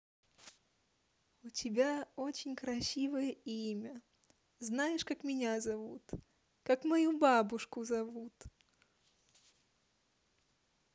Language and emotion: Russian, positive